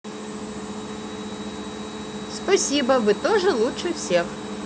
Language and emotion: Russian, positive